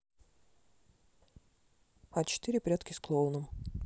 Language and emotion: Russian, neutral